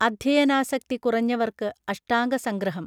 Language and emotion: Malayalam, neutral